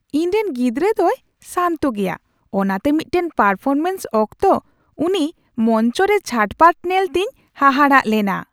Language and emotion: Santali, surprised